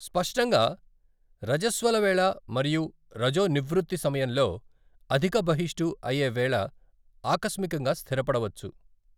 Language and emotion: Telugu, neutral